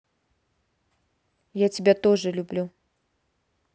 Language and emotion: Russian, neutral